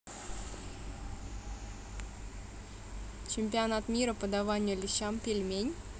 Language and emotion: Russian, neutral